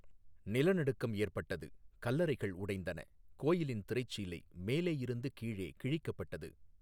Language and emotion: Tamil, neutral